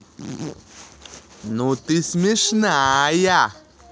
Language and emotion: Russian, positive